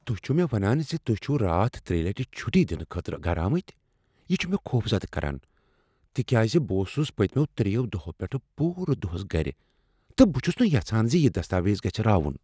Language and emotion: Kashmiri, fearful